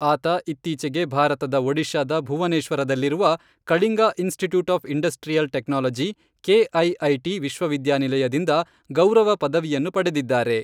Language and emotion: Kannada, neutral